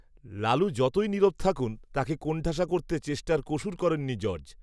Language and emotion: Bengali, neutral